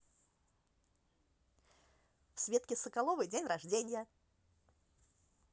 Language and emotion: Russian, positive